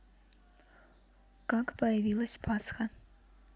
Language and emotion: Russian, neutral